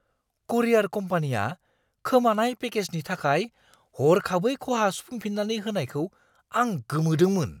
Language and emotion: Bodo, surprised